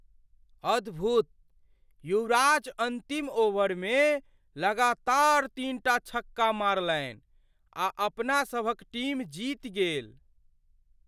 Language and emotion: Maithili, surprised